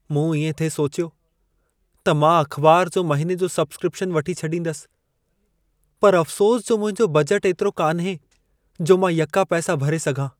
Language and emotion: Sindhi, sad